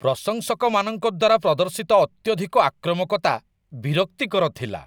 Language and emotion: Odia, disgusted